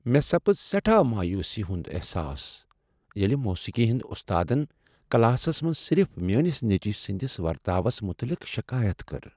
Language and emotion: Kashmiri, sad